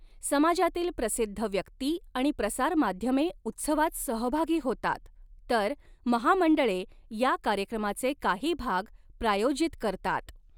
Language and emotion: Marathi, neutral